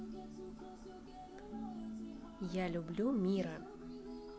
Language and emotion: Russian, neutral